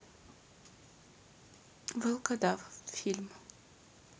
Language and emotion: Russian, neutral